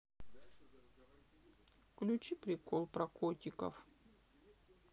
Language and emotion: Russian, sad